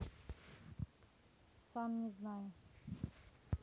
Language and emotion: Russian, neutral